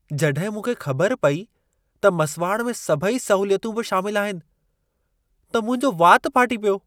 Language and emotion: Sindhi, surprised